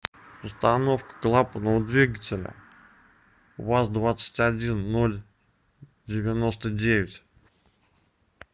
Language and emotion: Russian, neutral